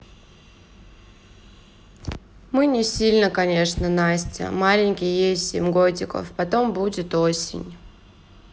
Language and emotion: Russian, sad